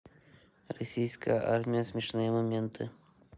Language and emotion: Russian, neutral